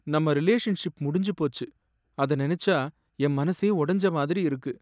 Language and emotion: Tamil, sad